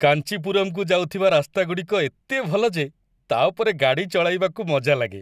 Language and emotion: Odia, happy